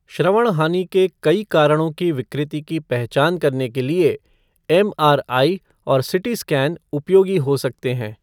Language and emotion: Hindi, neutral